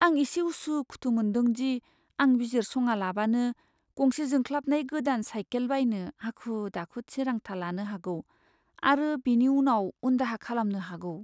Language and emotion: Bodo, fearful